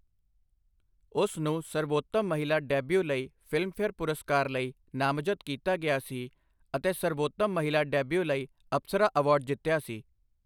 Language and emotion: Punjabi, neutral